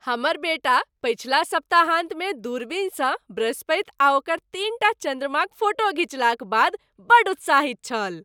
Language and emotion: Maithili, happy